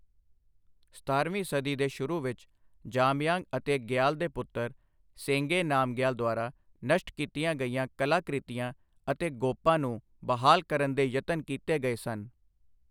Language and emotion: Punjabi, neutral